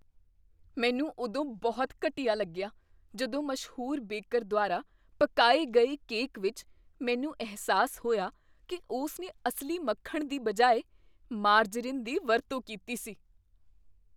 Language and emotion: Punjabi, disgusted